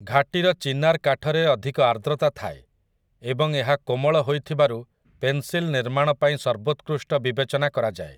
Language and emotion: Odia, neutral